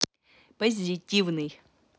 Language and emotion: Russian, positive